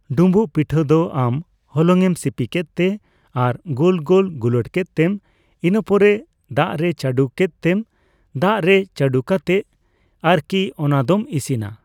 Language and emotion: Santali, neutral